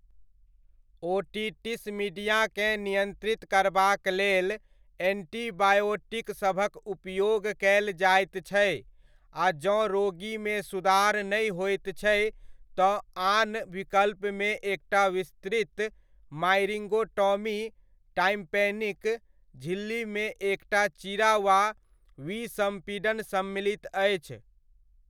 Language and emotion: Maithili, neutral